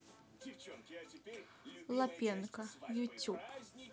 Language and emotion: Russian, neutral